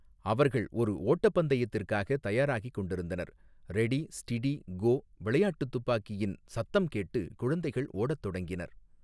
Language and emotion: Tamil, neutral